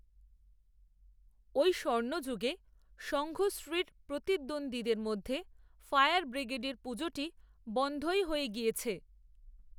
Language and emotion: Bengali, neutral